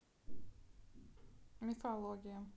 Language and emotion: Russian, neutral